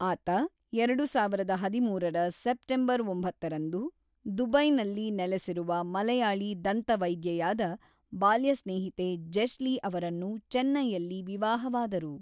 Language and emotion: Kannada, neutral